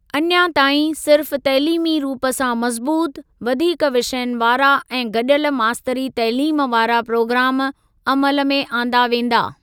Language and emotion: Sindhi, neutral